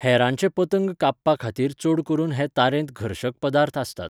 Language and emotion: Goan Konkani, neutral